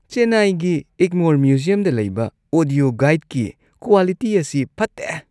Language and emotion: Manipuri, disgusted